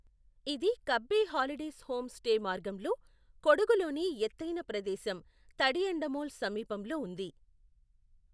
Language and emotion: Telugu, neutral